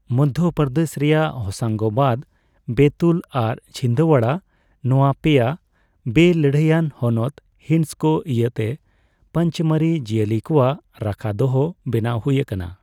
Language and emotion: Santali, neutral